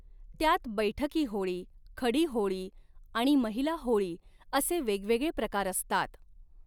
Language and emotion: Marathi, neutral